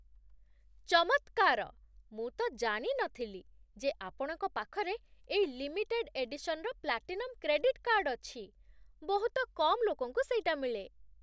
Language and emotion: Odia, surprised